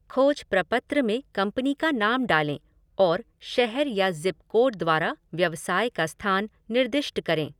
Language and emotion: Hindi, neutral